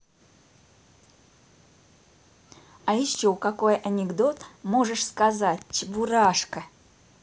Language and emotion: Russian, positive